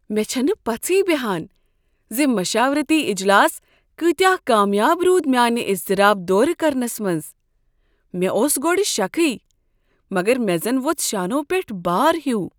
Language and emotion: Kashmiri, surprised